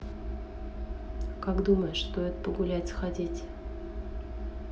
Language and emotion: Russian, neutral